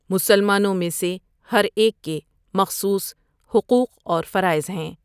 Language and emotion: Urdu, neutral